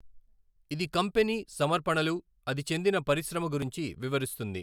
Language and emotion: Telugu, neutral